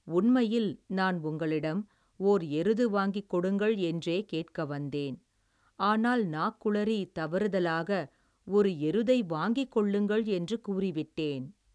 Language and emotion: Tamil, neutral